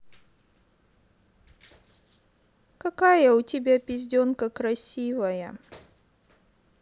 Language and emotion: Russian, sad